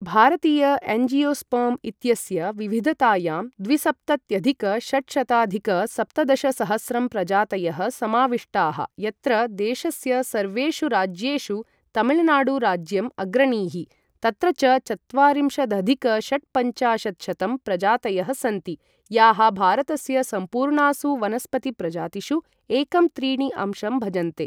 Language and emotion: Sanskrit, neutral